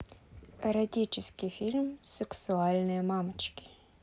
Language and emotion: Russian, neutral